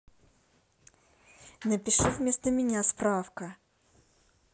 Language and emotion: Russian, angry